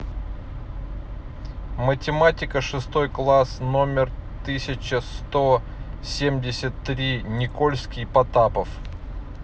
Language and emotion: Russian, neutral